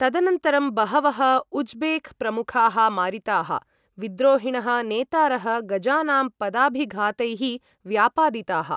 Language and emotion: Sanskrit, neutral